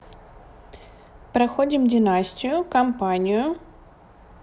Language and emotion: Russian, neutral